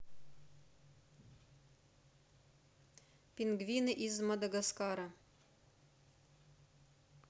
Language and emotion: Russian, neutral